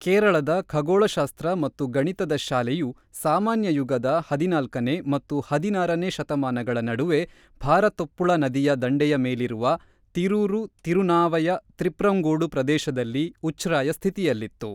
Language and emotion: Kannada, neutral